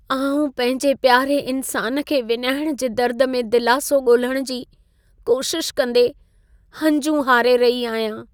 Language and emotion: Sindhi, sad